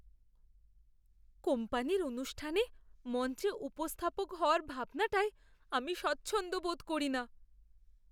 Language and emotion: Bengali, fearful